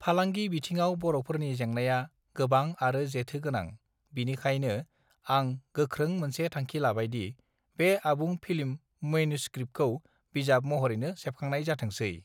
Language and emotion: Bodo, neutral